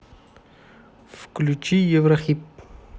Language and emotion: Russian, neutral